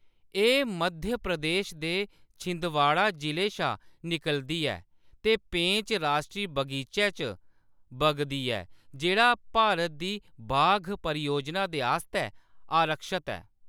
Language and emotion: Dogri, neutral